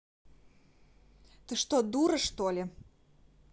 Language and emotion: Russian, angry